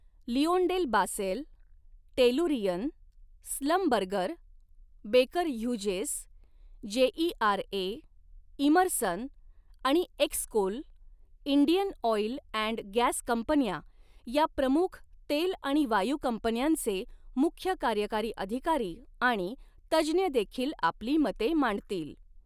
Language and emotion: Marathi, neutral